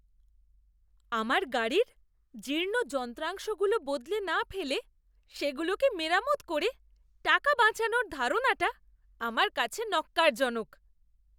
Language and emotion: Bengali, disgusted